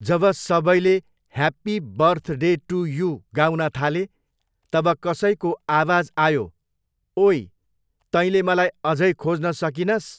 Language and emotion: Nepali, neutral